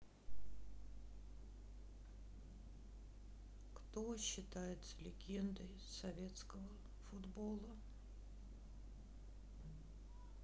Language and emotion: Russian, sad